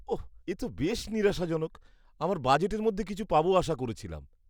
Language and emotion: Bengali, disgusted